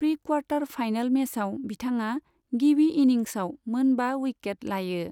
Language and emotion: Bodo, neutral